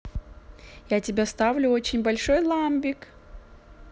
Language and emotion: Russian, positive